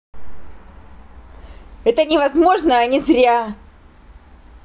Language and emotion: Russian, angry